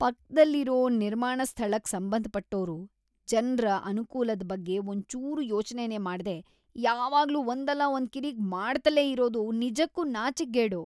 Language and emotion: Kannada, disgusted